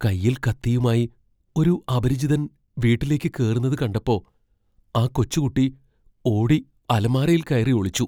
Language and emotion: Malayalam, fearful